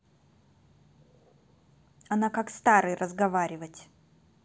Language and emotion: Russian, angry